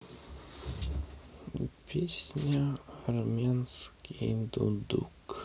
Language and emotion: Russian, sad